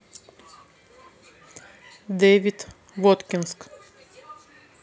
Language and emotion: Russian, neutral